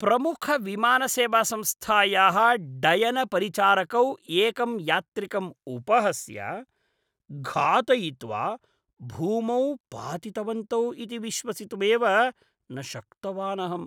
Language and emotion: Sanskrit, disgusted